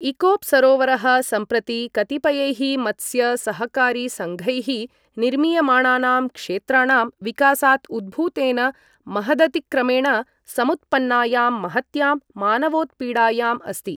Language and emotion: Sanskrit, neutral